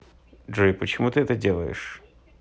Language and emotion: Russian, neutral